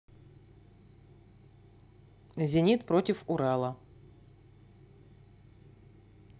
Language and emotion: Russian, neutral